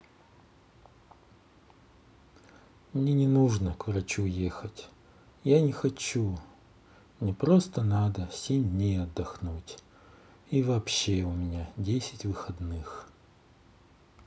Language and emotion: Russian, sad